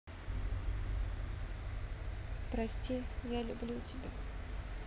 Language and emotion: Russian, sad